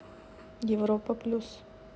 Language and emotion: Russian, neutral